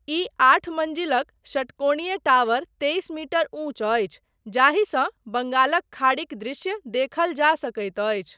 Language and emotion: Maithili, neutral